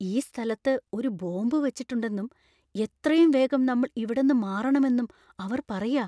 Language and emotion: Malayalam, fearful